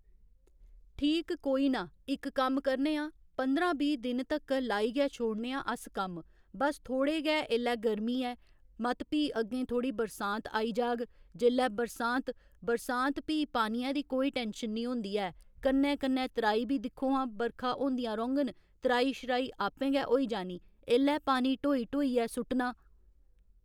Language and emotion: Dogri, neutral